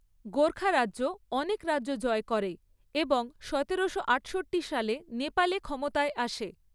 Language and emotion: Bengali, neutral